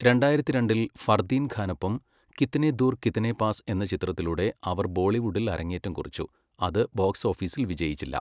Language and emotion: Malayalam, neutral